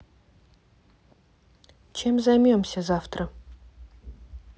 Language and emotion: Russian, neutral